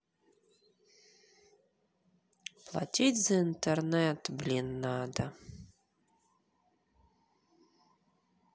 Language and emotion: Russian, sad